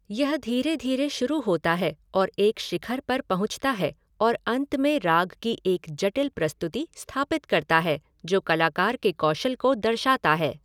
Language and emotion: Hindi, neutral